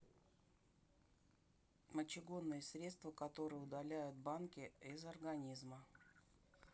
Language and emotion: Russian, neutral